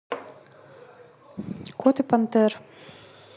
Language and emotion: Russian, neutral